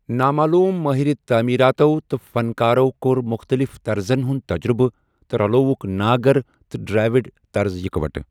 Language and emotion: Kashmiri, neutral